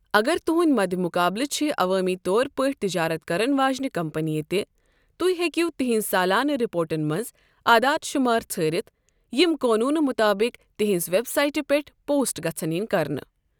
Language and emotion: Kashmiri, neutral